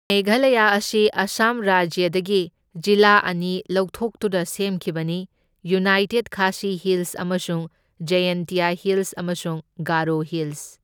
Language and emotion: Manipuri, neutral